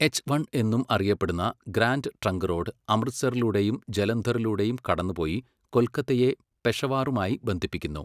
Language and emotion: Malayalam, neutral